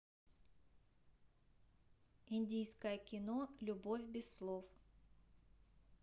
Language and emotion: Russian, neutral